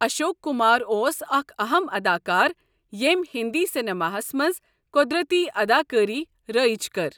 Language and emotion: Kashmiri, neutral